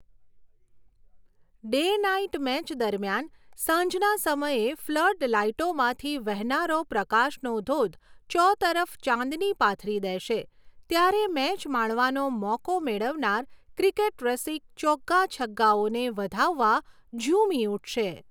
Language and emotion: Gujarati, neutral